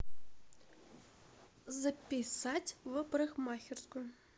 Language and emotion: Russian, neutral